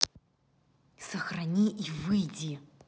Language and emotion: Russian, neutral